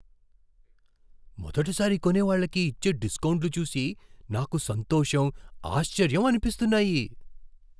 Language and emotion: Telugu, surprised